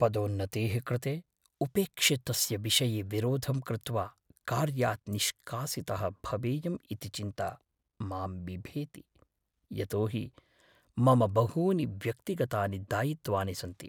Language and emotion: Sanskrit, fearful